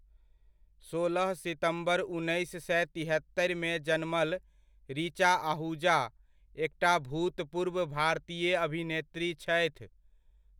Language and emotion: Maithili, neutral